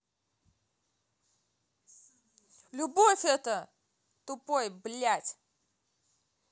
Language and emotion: Russian, angry